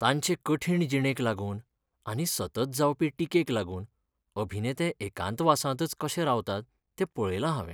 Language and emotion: Goan Konkani, sad